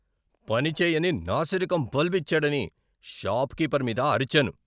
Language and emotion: Telugu, angry